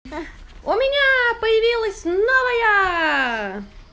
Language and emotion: Russian, positive